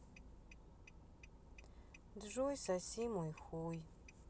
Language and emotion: Russian, sad